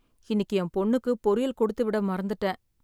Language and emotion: Tamil, sad